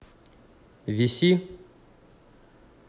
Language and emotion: Russian, neutral